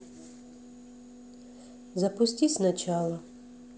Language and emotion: Russian, neutral